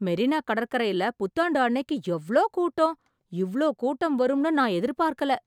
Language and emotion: Tamil, surprised